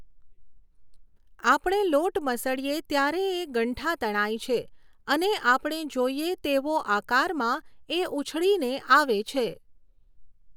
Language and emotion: Gujarati, neutral